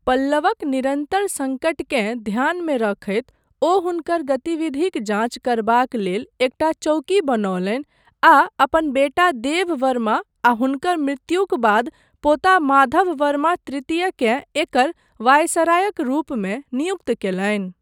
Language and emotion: Maithili, neutral